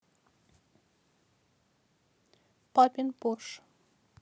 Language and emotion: Russian, neutral